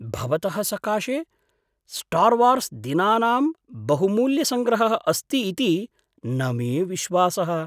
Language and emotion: Sanskrit, surprised